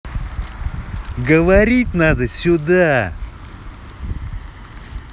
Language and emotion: Russian, angry